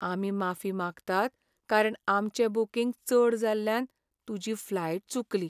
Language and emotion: Goan Konkani, sad